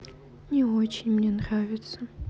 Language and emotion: Russian, sad